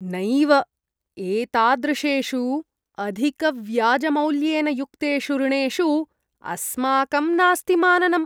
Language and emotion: Sanskrit, disgusted